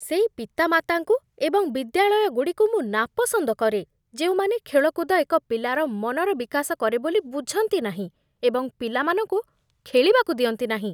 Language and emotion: Odia, disgusted